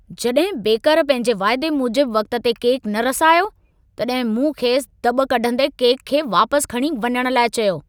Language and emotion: Sindhi, angry